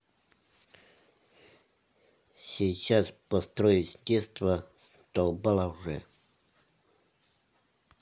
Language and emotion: Russian, neutral